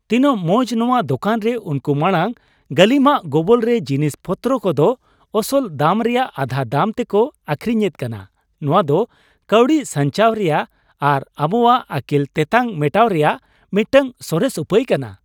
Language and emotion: Santali, happy